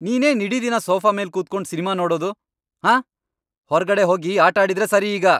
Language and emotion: Kannada, angry